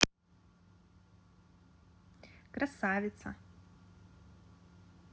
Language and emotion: Russian, positive